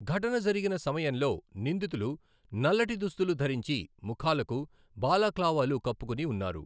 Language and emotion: Telugu, neutral